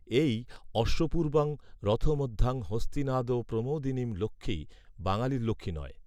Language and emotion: Bengali, neutral